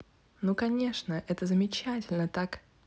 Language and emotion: Russian, positive